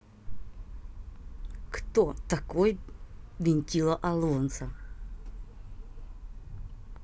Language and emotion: Russian, angry